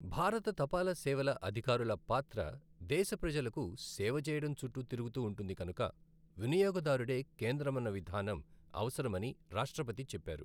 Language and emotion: Telugu, neutral